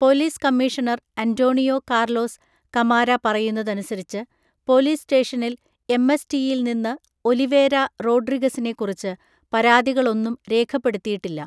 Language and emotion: Malayalam, neutral